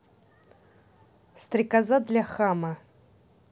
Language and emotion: Russian, neutral